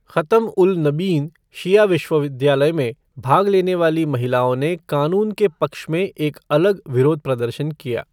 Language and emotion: Hindi, neutral